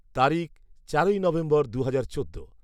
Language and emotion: Bengali, neutral